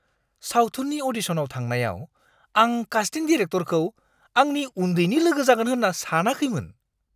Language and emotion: Bodo, surprised